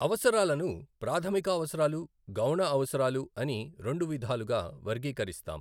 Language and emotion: Telugu, neutral